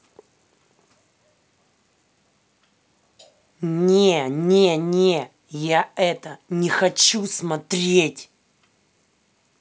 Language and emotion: Russian, angry